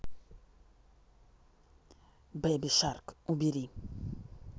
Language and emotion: Russian, neutral